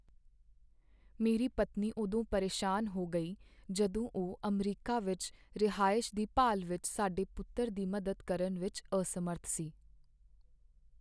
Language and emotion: Punjabi, sad